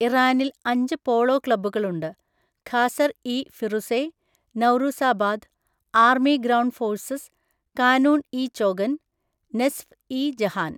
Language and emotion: Malayalam, neutral